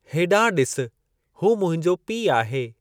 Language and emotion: Sindhi, neutral